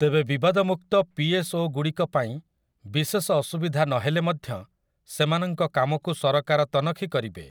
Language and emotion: Odia, neutral